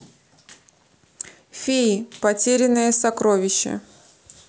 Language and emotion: Russian, neutral